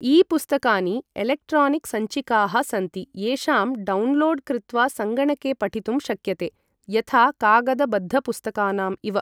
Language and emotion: Sanskrit, neutral